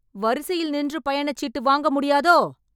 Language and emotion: Tamil, angry